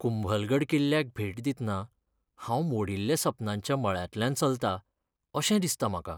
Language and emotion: Goan Konkani, sad